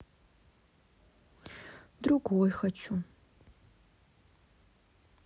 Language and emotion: Russian, sad